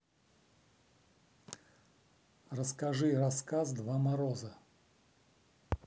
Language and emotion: Russian, neutral